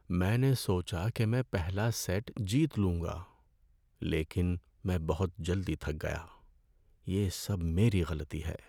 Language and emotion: Urdu, sad